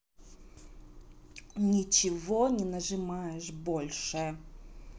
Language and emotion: Russian, angry